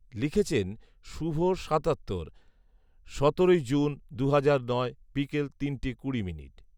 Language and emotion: Bengali, neutral